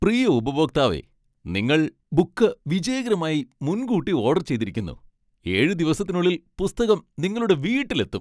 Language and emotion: Malayalam, happy